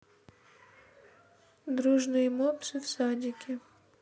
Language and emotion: Russian, neutral